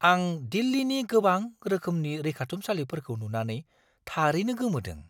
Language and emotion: Bodo, surprised